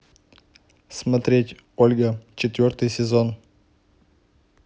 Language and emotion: Russian, neutral